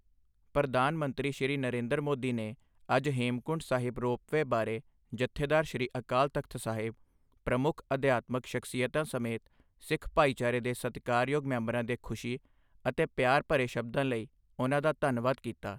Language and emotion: Punjabi, neutral